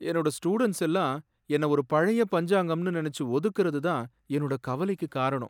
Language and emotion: Tamil, sad